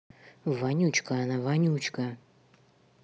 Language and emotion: Russian, angry